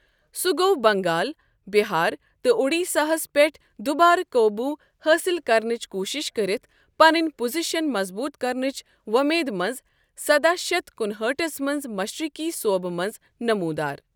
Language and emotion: Kashmiri, neutral